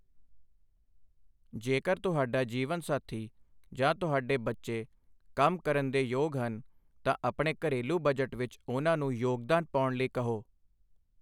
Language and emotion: Punjabi, neutral